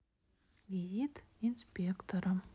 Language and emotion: Russian, neutral